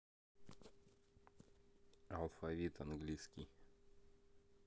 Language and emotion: Russian, neutral